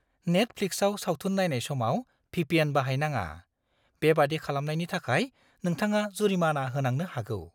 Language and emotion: Bodo, fearful